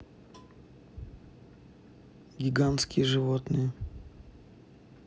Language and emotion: Russian, neutral